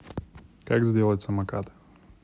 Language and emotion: Russian, neutral